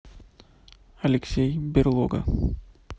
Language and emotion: Russian, neutral